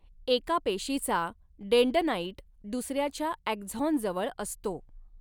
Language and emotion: Marathi, neutral